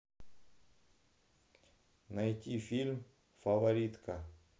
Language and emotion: Russian, neutral